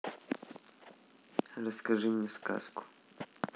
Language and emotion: Russian, neutral